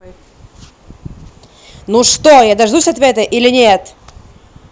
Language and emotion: Russian, angry